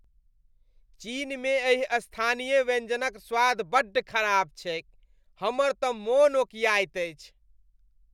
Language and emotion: Maithili, disgusted